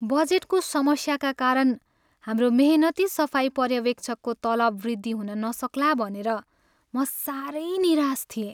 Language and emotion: Nepali, sad